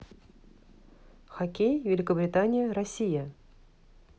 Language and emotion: Russian, neutral